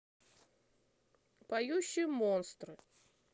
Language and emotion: Russian, neutral